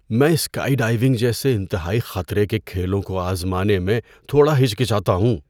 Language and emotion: Urdu, fearful